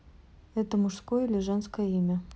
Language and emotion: Russian, neutral